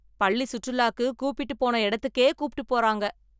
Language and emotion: Tamil, angry